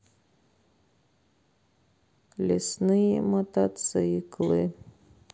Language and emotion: Russian, neutral